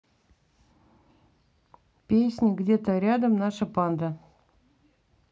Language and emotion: Russian, neutral